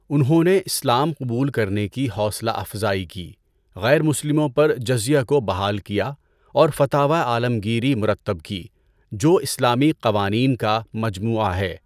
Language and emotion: Urdu, neutral